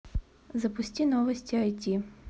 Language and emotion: Russian, neutral